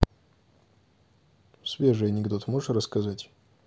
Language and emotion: Russian, neutral